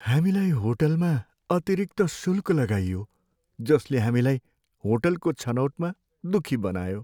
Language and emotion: Nepali, sad